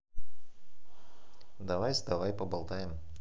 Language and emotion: Russian, neutral